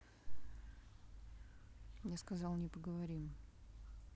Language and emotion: Russian, neutral